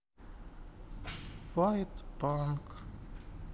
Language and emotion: Russian, sad